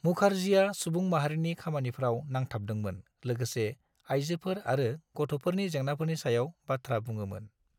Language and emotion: Bodo, neutral